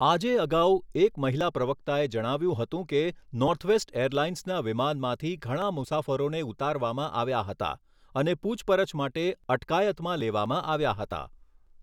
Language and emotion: Gujarati, neutral